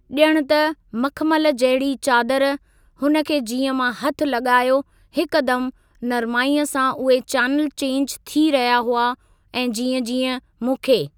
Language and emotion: Sindhi, neutral